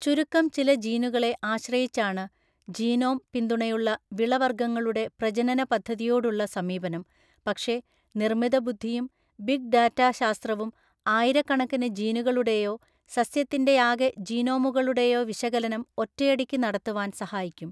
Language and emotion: Malayalam, neutral